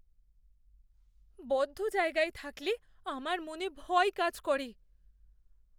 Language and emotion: Bengali, fearful